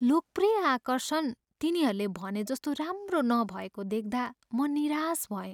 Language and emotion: Nepali, sad